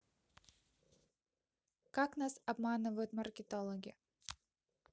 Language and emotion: Russian, neutral